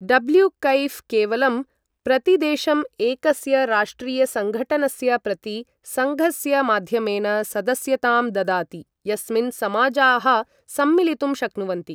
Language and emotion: Sanskrit, neutral